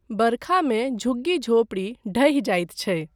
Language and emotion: Maithili, neutral